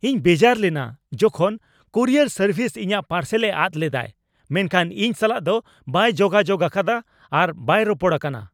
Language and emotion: Santali, angry